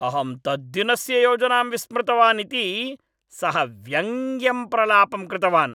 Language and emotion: Sanskrit, angry